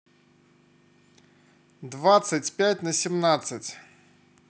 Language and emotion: Russian, neutral